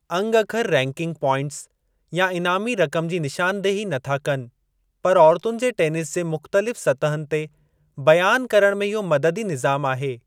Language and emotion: Sindhi, neutral